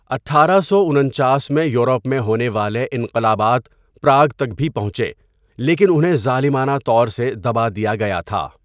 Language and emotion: Urdu, neutral